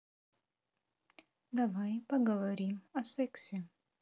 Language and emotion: Russian, neutral